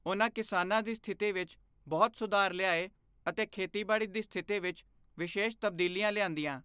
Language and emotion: Punjabi, neutral